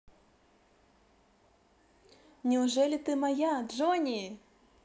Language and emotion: Russian, positive